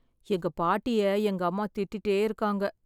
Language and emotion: Tamil, sad